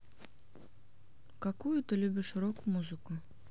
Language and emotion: Russian, neutral